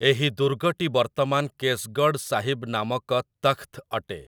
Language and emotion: Odia, neutral